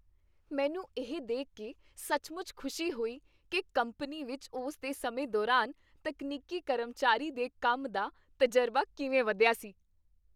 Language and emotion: Punjabi, happy